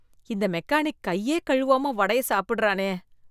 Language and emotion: Tamil, disgusted